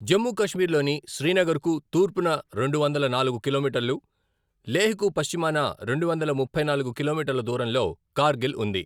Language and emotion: Telugu, neutral